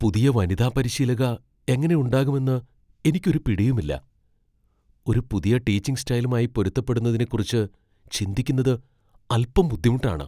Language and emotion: Malayalam, fearful